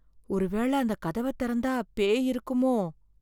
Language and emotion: Tamil, fearful